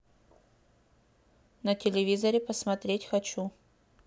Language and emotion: Russian, neutral